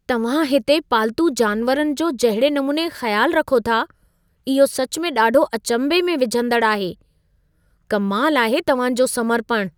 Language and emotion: Sindhi, surprised